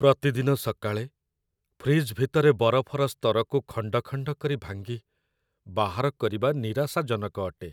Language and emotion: Odia, sad